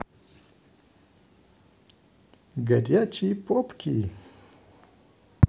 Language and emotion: Russian, positive